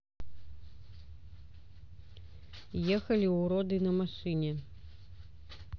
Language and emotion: Russian, neutral